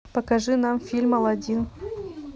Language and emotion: Russian, neutral